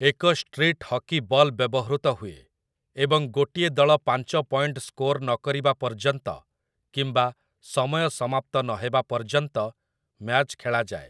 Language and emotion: Odia, neutral